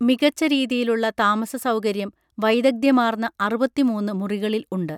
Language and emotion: Malayalam, neutral